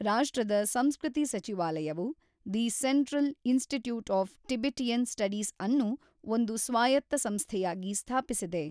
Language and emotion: Kannada, neutral